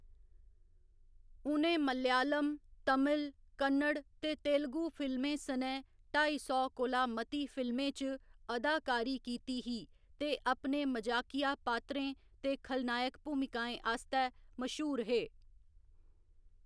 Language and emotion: Dogri, neutral